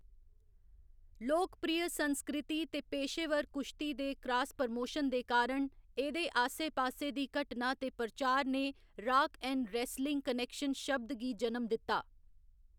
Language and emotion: Dogri, neutral